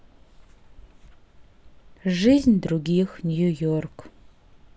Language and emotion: Russian, sad